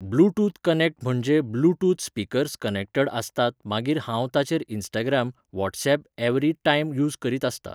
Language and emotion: Goan Konkani, neutral